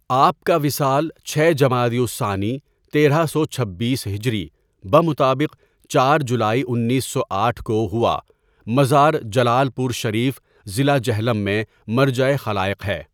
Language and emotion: Urdu, neutral